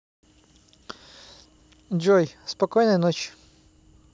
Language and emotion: Russian, neutral